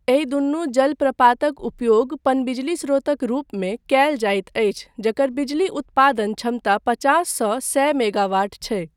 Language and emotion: Maithili, neutral